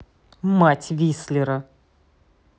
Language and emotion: Russian, angry